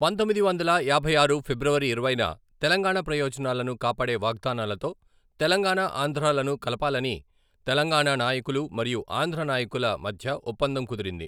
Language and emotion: Telugu, neutral